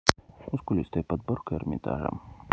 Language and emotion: Russian, neutral